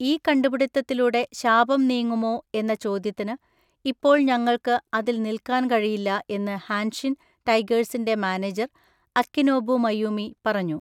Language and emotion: Malayalam, neutral